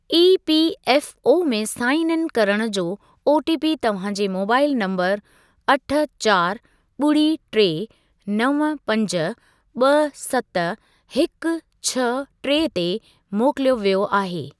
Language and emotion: Sindhi, neutral